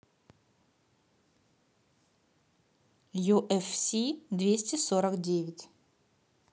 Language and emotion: Russian, neutral